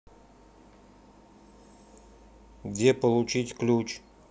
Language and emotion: Russian, neutral